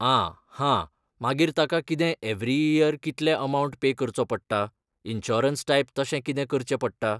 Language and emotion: Goan Konkani, neutral